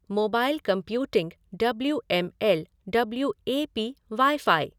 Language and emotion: Hindi, neutral